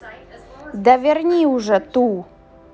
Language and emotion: Russian, angry